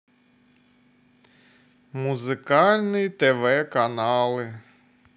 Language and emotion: Russian, positive